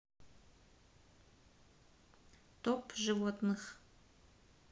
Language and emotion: Russian, neutral